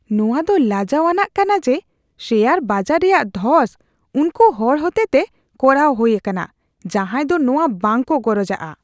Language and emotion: Santali, disgusted